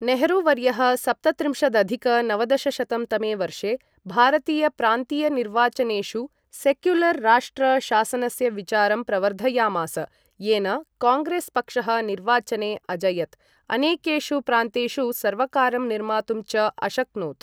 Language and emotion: Sanskrit, neutral